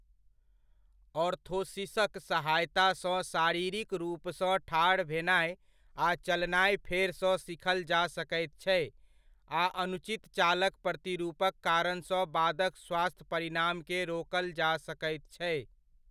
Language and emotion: Maithili, neutral